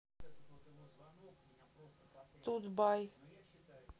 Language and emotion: Russian, neutral